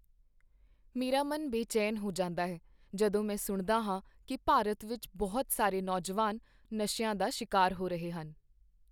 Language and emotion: Punjabi, sad